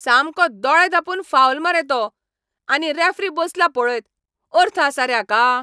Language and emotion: Goan Konkani, angry